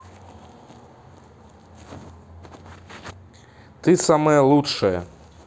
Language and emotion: Russian, positive